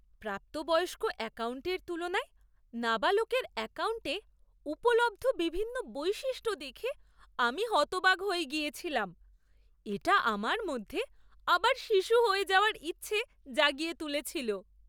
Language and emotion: Bengali, surprised